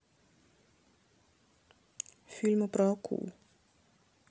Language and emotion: Russian, neutral